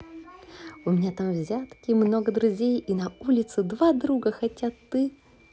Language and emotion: Russian, positive